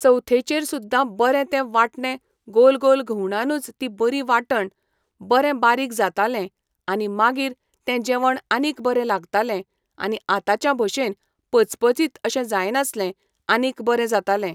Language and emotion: Goan Konkani, neutral